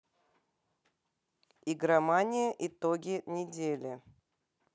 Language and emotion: Russian, neutral